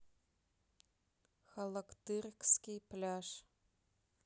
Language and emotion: Russian, neutral